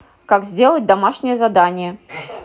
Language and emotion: Russian, neutral